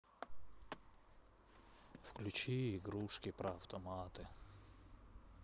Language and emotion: Russian, sad